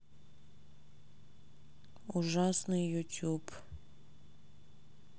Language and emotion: Russian, sad